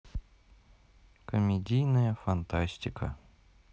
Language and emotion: Russian, neutral